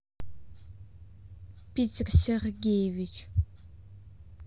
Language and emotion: Russian, neutral